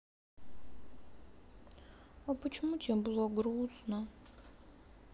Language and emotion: Russian, sad